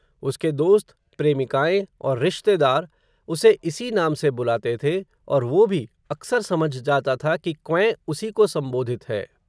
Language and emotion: Hindi, neutral